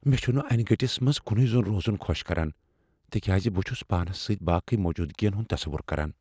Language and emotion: Kashmiri, fearful